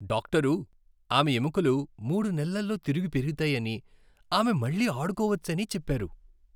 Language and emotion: Telugu, happy